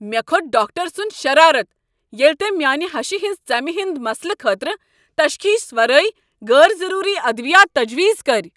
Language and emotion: Kashmiri, angry